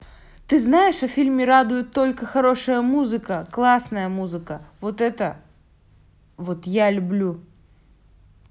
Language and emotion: Russian, neutral